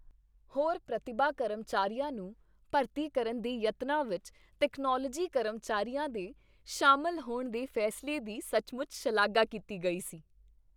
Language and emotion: Punjabi, happy